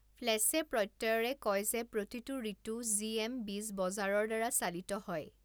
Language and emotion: Assamese, neutral